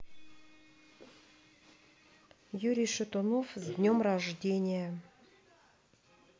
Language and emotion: Russian, neutral